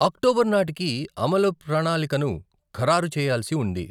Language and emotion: Telugu, neutral